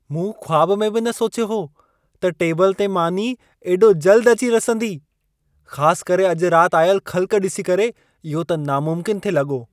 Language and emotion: Sindhi, surprised